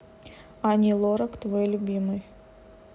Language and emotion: Russian, neutral